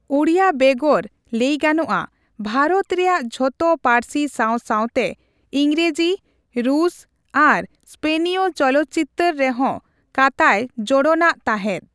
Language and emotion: Santali, neutral